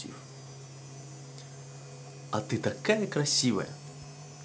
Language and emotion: Russian, positive